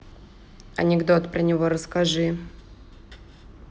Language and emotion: Russian, neutral